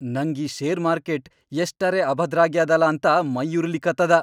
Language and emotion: Kannada, angry